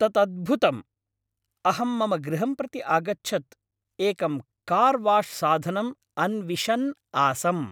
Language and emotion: Sanskrit, happy